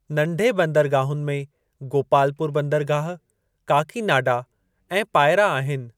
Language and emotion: Sindhi, neutral